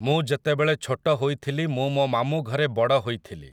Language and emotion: Odia, neutral